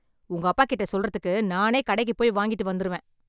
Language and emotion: Tamil, angry